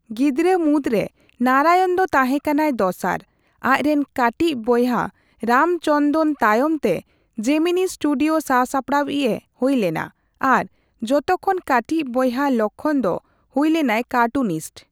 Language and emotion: Santali, neutral